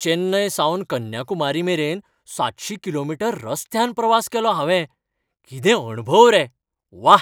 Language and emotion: Goan Konkani, happy